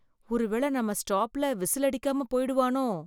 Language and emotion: Tamil, fearful